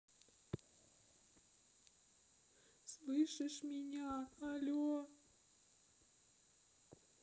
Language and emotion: Russian, sad